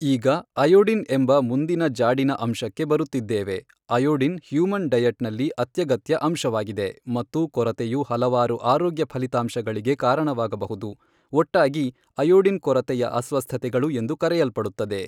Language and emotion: Kannada, neutral